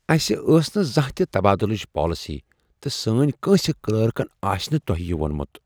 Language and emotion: Kashmiri, surprised